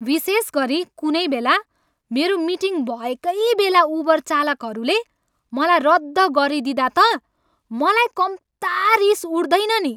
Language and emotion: Nepali, angry